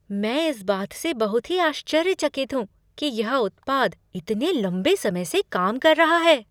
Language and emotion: Hindi, surprised